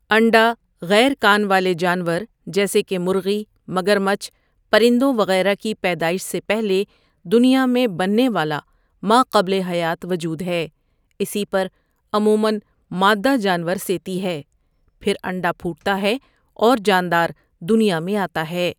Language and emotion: Urdu, neutral